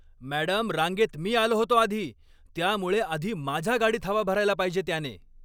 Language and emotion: Marathi, angry